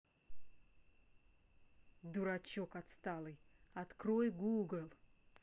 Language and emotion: Russian, angry